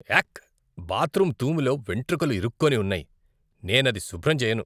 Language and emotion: Telugu, disgusted